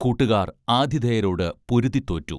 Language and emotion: Malayalam, neutral